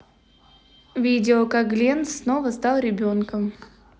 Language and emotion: Russian, neutral